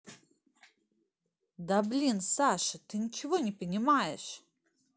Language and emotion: Russian, angry